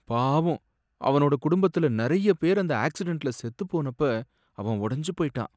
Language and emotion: Tamil, sad